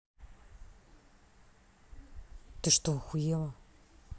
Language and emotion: Russian, angry